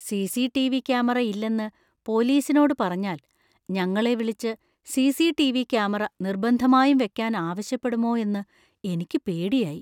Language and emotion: Malayalam, fearful